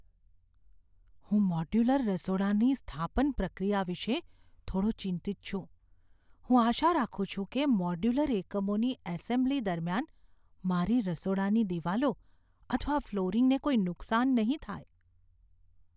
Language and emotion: Gujarati, fearful